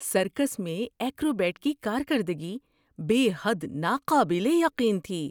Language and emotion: Urdu, surprised